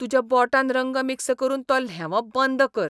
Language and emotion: Goan Konkani, disgusted